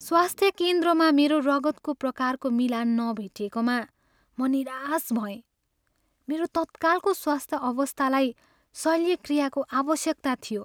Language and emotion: Nepali, sad